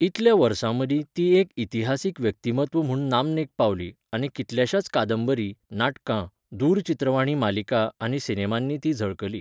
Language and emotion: Goan Konkani, neutral